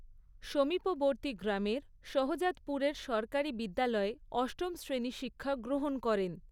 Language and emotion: Bengali, neutral